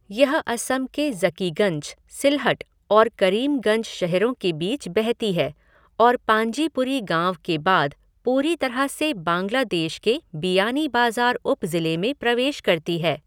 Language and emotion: Hindi, neutral